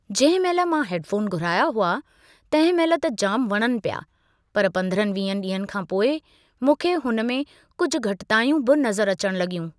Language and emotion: Sindhi, neutral